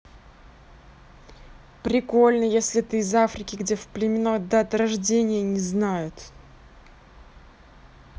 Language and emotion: Russian, neutral